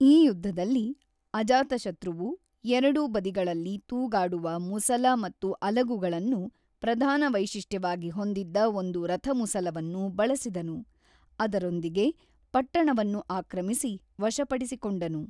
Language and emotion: Kannada, neutral